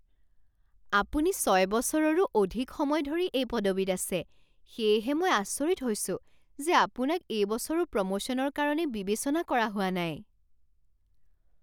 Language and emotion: Assamese, surprised